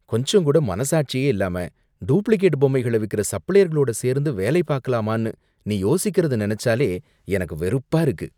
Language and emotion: Tamil, disgusted